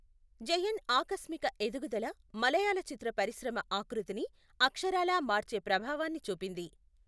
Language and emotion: Telugu, neutral